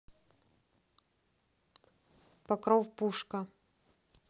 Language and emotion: Russian, neutral